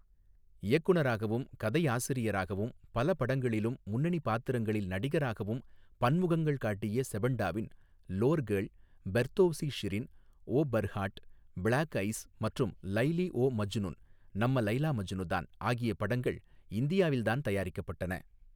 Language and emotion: Tamil, neutral